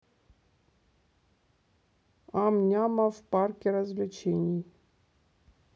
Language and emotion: Russian, neutral